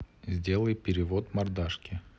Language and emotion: Russian, neutral